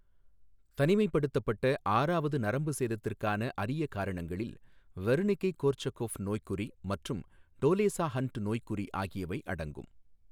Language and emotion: Tamil, neutral